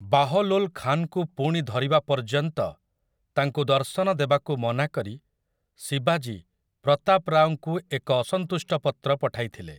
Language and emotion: Odia, neutral